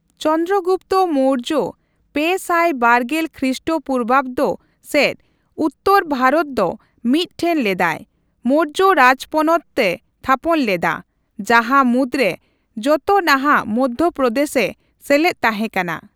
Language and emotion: Santali, neutral